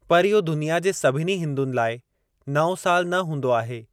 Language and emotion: Sindhi, neutral